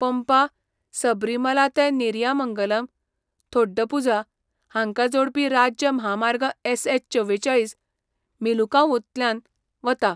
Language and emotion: Goan Konkani, neutral